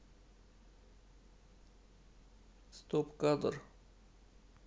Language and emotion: Russian, neutral